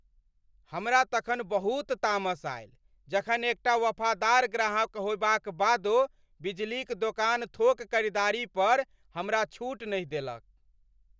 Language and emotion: Maithili, angry